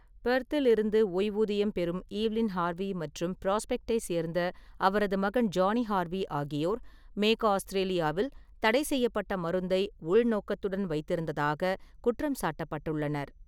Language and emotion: Tamil, neutral